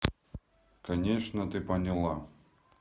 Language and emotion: Russian, neutral